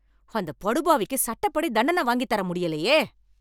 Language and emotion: Tamil, angry